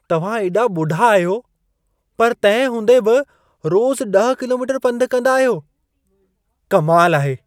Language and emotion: Sindhi, surprised